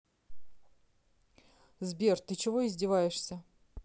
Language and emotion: Russian, angry